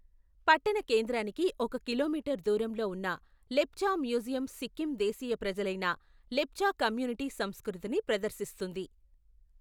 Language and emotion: Telugu, neutral